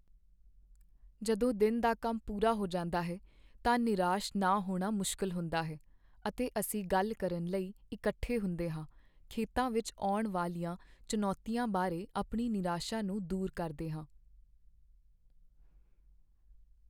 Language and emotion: Punjabi, sad